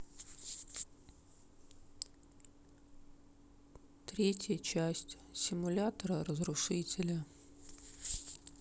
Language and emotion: Russian, sad